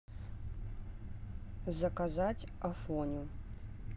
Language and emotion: Russian, neutral